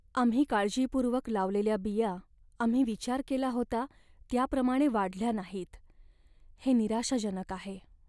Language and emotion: Marathi, sad